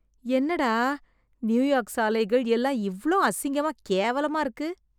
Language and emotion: Tamil, disgusted